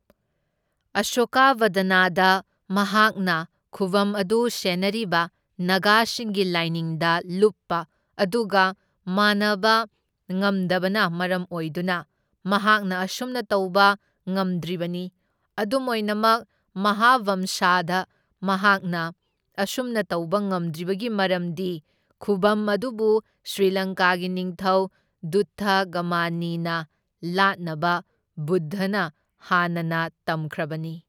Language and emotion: Manipuri, neutral